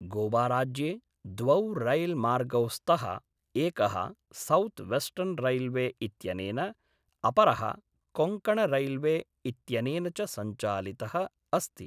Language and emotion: Sanskrit, neutral